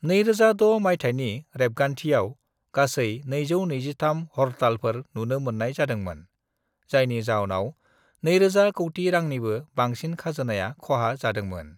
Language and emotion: Bodo, neutral